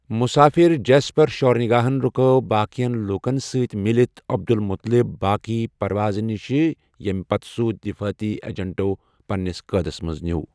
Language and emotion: Kashmiri, neutral